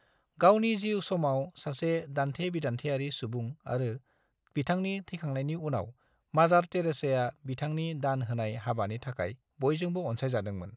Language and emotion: Bodo, neutral